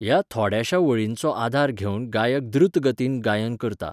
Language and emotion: Goan Konkani, neutral